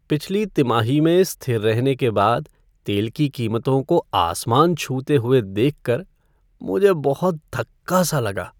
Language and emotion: Hindi, sad